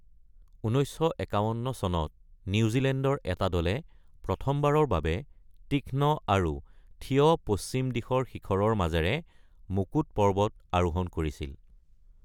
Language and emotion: Assamese, neutral